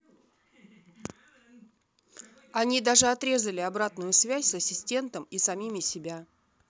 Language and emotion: Russian, neutral